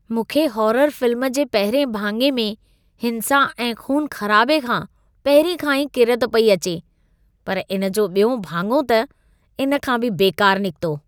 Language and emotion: Sindhi, disgusted